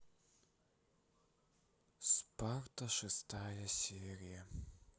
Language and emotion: Russian, sad